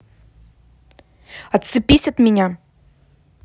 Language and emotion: Russian, angry